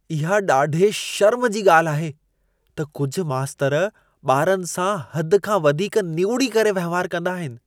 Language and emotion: Sindhi, disgusted